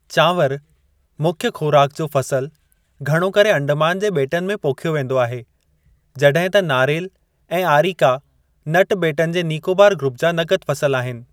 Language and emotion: Sindhi, neutral